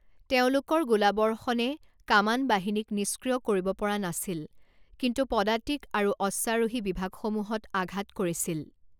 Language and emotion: Assamese, neutral